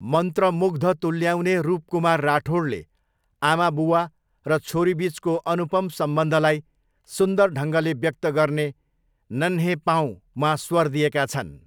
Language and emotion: Nepali, neutral